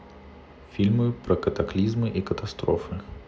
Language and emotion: Russian, neutral